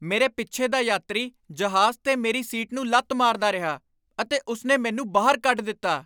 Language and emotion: Punjabi, angry